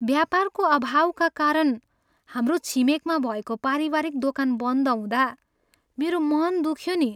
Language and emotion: Nepali, sad